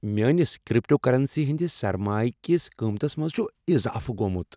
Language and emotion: Kashmiri, happy